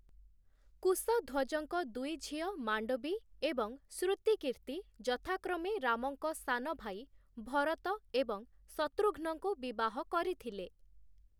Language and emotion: Odia, neutral